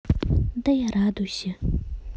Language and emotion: Russian, neutral